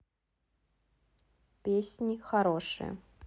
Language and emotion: Russian, neutral